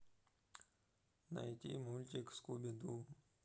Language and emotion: Russian, sad